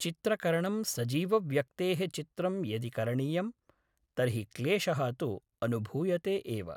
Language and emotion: Sanskrit, neutral